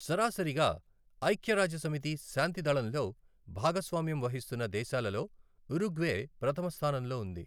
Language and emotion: Telugu, neutral